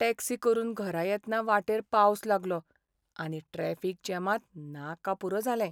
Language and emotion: Goan Konkani, sad